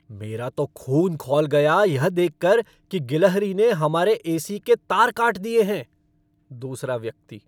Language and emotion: Hindi, angry